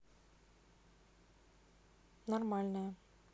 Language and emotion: Russian, neutral